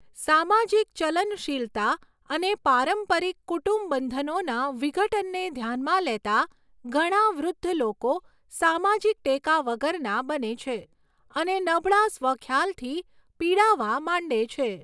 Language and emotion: Gujarati, neutral